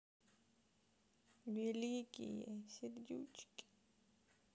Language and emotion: Russian, sad